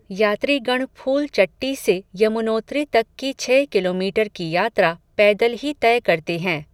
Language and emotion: Hindi, neutral